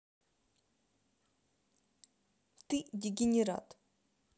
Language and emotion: Russian, angry